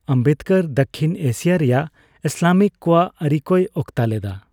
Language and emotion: Santali, neutral